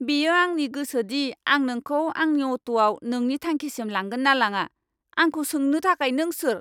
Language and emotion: Bodo, angry